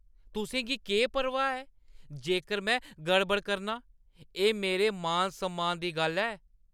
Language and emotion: Dogri, angry